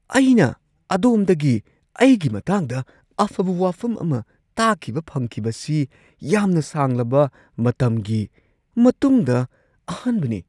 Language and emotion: Manipuri, surprised